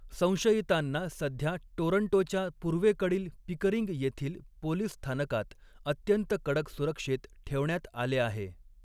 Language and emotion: Marathi, neutral